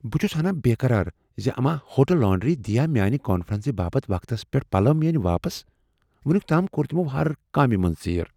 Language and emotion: Kashmiri, fearful